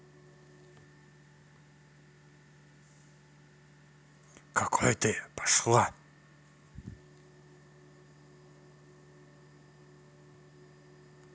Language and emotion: Russian, angry